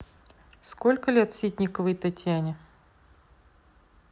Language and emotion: Russian, neutral